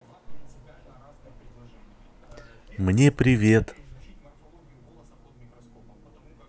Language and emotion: Russian, positive